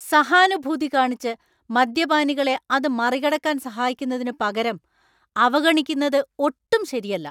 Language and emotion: Malayalam, angry